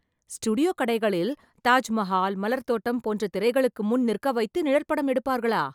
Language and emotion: Tamil, surprised